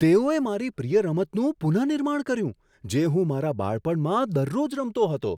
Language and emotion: Gujarati, surprised